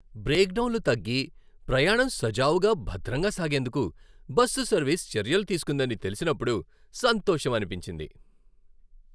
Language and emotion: Telugu, happy